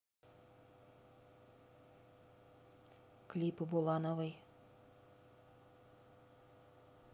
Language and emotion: Russian, neutral